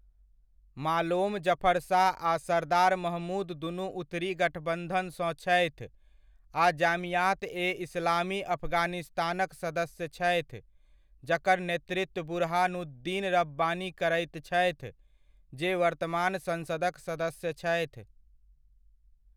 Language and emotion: Maithili, neutral